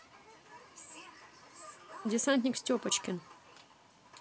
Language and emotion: Russian, neutral